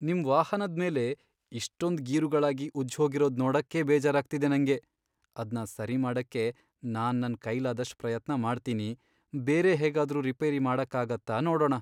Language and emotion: Kannada, sad